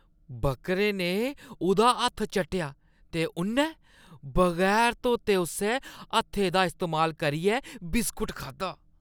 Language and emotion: Dogri, disgusted